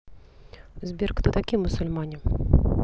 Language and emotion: Russian, neutral